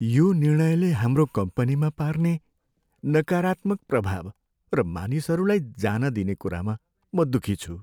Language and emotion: Nepali, sad